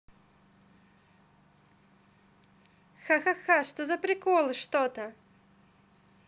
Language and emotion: Russian, positive